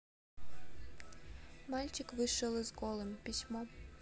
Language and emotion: Russian, sad